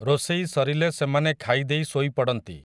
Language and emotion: Odia, neutral